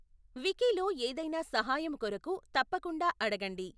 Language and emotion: Telugu, neutral